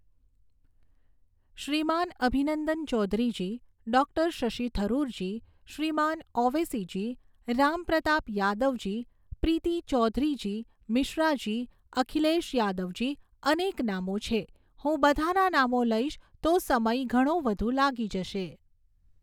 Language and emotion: Gujarati, neutral